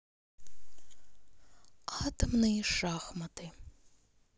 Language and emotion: Russian, neutral